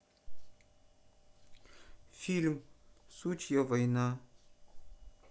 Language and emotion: Russian, neutral